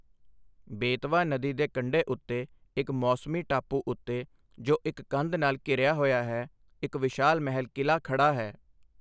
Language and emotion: Punjabi, neutral